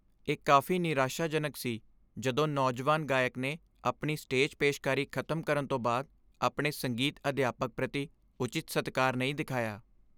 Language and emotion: Punjabi, sad